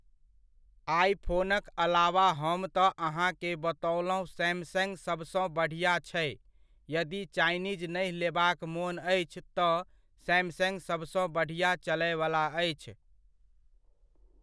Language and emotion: Maithili, neutral